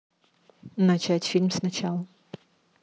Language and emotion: Russian, neutral